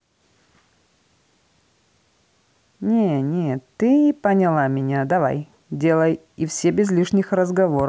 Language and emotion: Russian, neutral